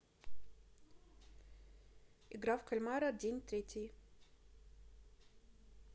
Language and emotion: Russian, neutral